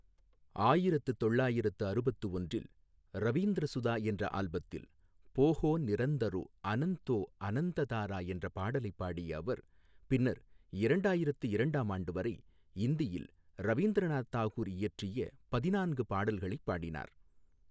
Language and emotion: Tamil, neutral